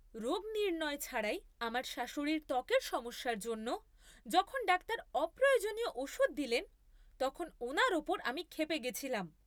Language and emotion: Bengali, angry